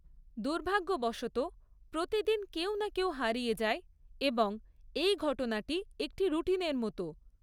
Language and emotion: Bengali, neutral